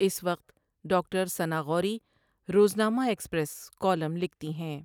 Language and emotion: Urdu, neutral